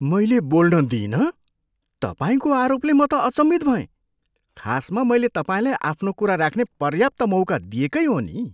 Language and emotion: Nepali, surprised